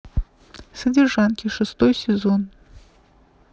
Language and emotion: Russian, neutral